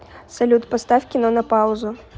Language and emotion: Russian, neutral